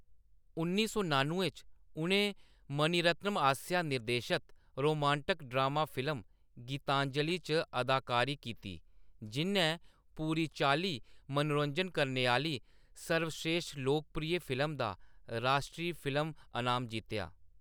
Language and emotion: Dogri, neutral